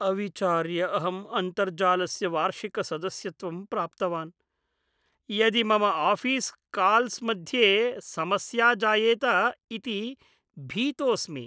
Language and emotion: Sanskrit, fearful